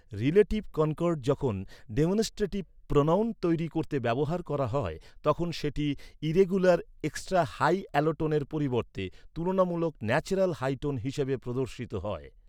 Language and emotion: Bengali, neutral